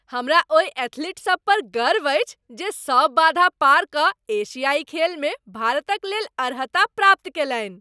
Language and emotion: Maithili, happy